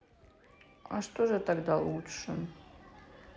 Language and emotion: Russian, sad